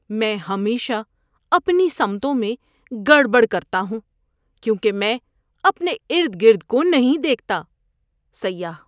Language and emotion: Urdu, disgusted